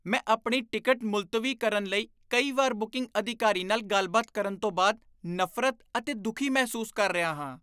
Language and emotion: Punjabi, disgusted